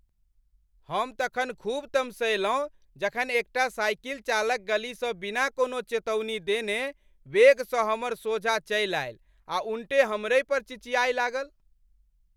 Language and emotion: Maithili, angry